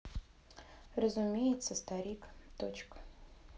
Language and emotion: Russian, neutral